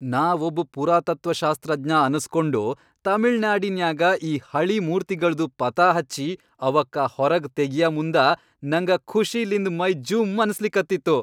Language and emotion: Kannada, happy